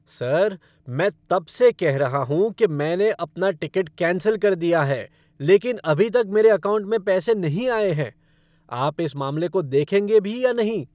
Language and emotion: Hindi, angry